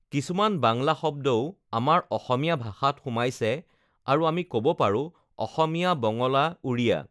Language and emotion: Assamese, neutral